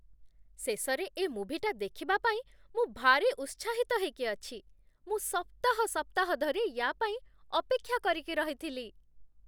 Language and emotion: Odia, happy